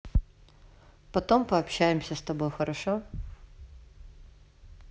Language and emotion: Russian, neutral